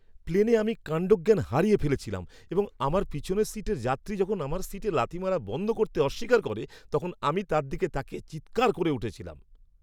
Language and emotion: Bengali, angry